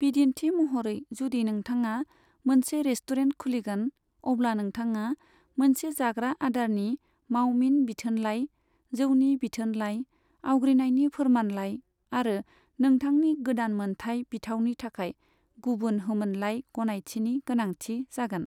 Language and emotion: Bodo, neutral